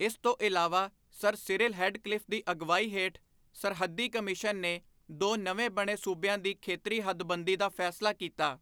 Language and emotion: Punjabi, neutral